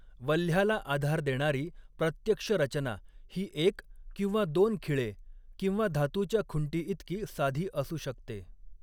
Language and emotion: Marathi, neutral